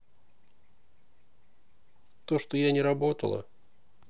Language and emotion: Russian, neutral